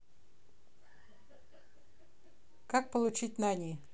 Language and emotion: Russian, neutral